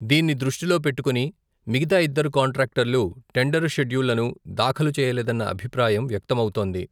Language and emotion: Telugu, neutral